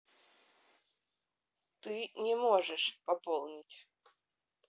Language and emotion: Russian, neutral